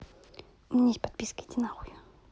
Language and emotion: Russian, angry